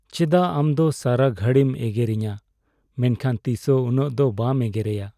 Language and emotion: Santali, sad